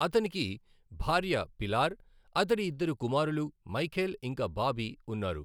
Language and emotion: Telugu, neutral